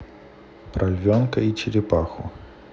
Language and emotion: Russian, neutral